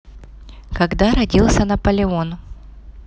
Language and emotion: Russian, neutral